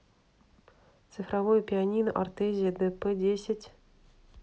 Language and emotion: Russian, neutral